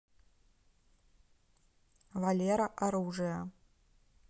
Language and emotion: Russian, neutral